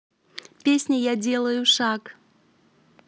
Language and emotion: Russian, positive